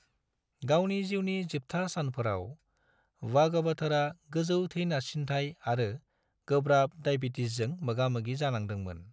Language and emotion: Bodo, neutral